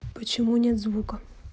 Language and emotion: Russian, neutral